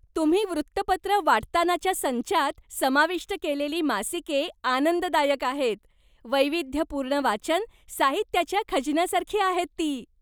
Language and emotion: Marathi, happy